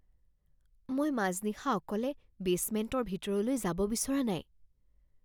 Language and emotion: Assamese, fearful